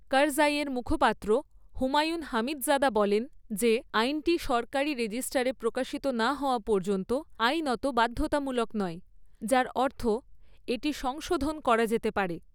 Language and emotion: Bengali, neutral